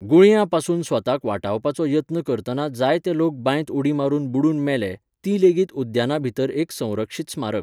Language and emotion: Goan Konkani, neutral